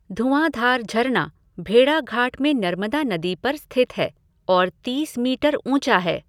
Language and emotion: Hindi, neutral